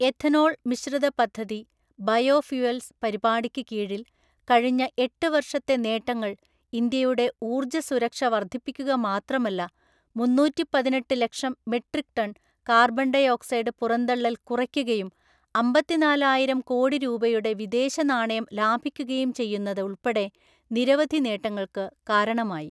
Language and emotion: Malayalam, neutral